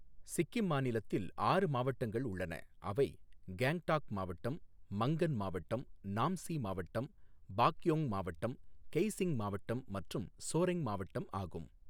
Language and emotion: Tamil, neutral